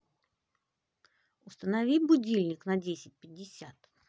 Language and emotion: Russian, positive